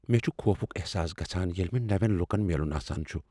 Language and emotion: Kashmiri, fearful